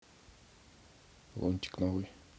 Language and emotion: Russian, neutral